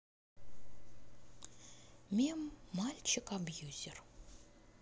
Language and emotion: Russian, neutral